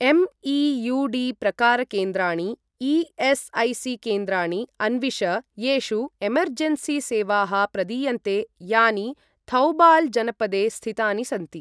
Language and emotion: Sanskrit, neutral